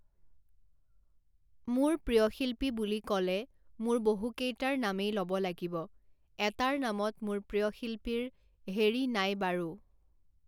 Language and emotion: Assamese, neutral